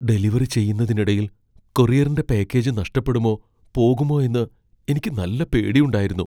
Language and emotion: Malayalam, fearful